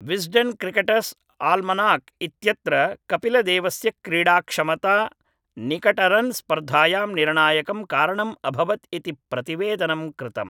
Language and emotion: Sanskrit, neutral